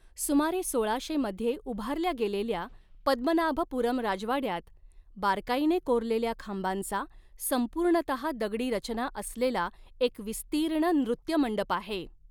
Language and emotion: Marathi, neutral